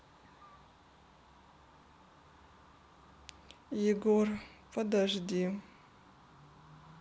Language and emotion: Russian, sad